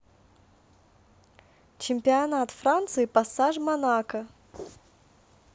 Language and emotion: Russian, neutral